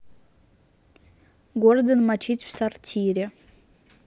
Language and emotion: Russian, neutral